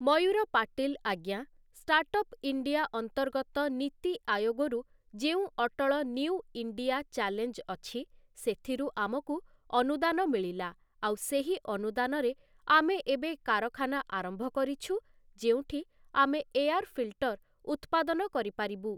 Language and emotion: Odia, neutral